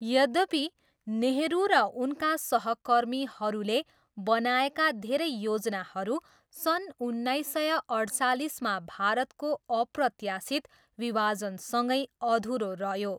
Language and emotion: Nepali, neutral